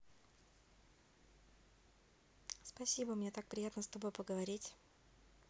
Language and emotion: Russian, neutral